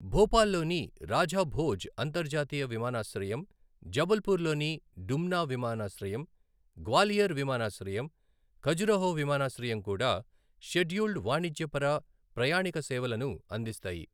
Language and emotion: Telugu, neutral